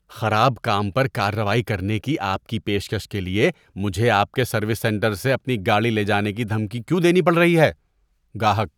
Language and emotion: Urdu, disgusted